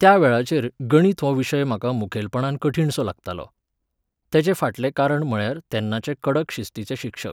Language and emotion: Goan Konkani, neutral